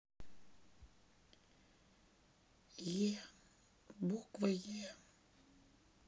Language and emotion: Russian, sad